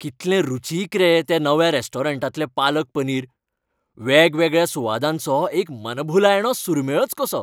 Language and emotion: Goan Konkani, happy